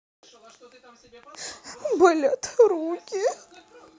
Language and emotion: Russian, sad